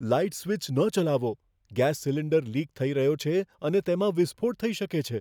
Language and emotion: Gujarati, fearful